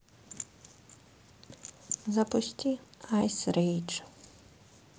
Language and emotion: Russian, sad